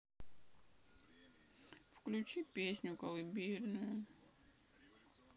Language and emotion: Russian, sad